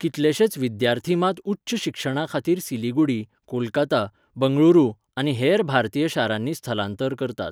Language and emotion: Goan Konkani, neutral